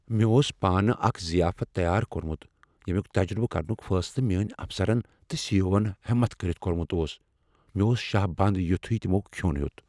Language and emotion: Kashmiri, fearful